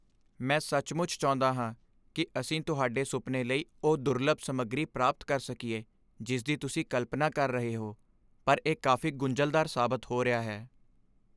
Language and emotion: Punjabi, sad